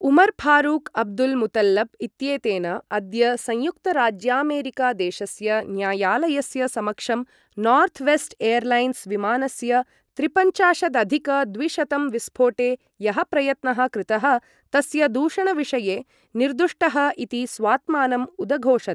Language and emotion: Sanskrit, neutral